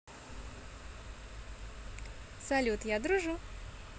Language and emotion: Russian, positive